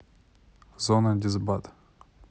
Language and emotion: Russian, neutral